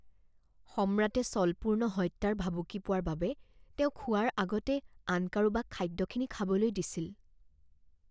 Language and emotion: Assamese, fearful